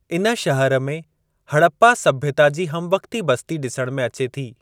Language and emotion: Sindhi, neutral